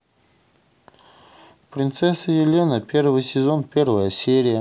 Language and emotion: Russian, neutral